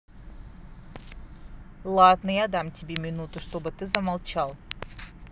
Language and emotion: Russian, neutral